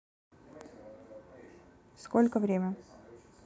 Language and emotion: Russian, neutral